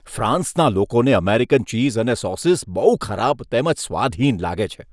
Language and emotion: Gujarati, disgusted